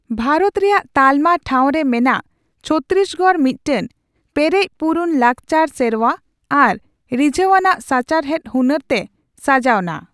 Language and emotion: Santali, neutral